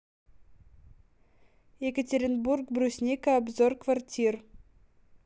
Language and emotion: Russian, neutral